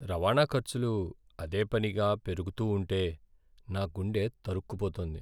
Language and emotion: Telugu, sad